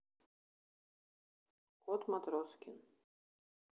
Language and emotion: Russian, neutral